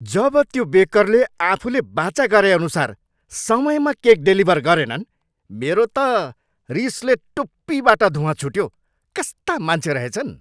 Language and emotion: Nepali, angry